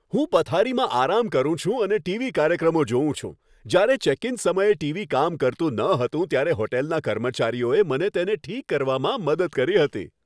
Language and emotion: Gujarati, happy